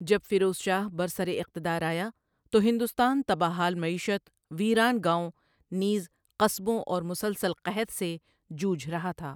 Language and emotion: Urdu, neutral